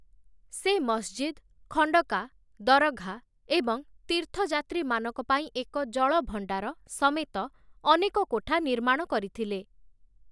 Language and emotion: Odia, neutral